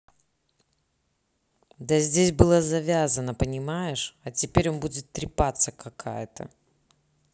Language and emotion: Russian, angry